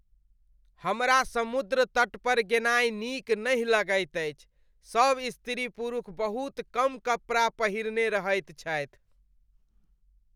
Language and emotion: Maithili, disgusted